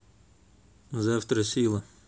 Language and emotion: Russian, neutral